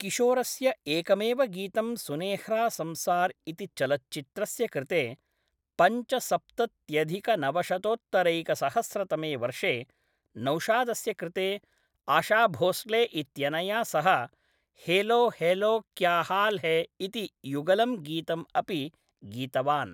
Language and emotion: Sanskrit, neutral